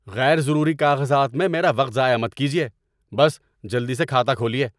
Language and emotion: Urdu, angry